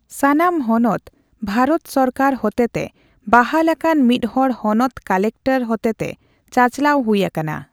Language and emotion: Santali, neutral